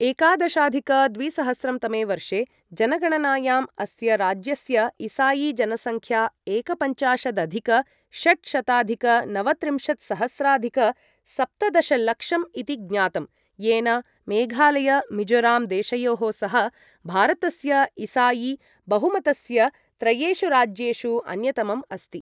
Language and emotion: Sanskrit, neutral